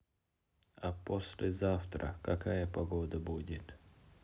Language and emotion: Russian, neutral